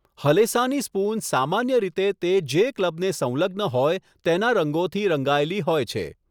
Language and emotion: Gujarati, neutral